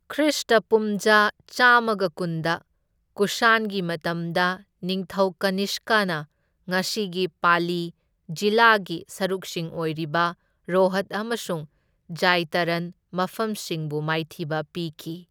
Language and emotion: Manipuri, neutral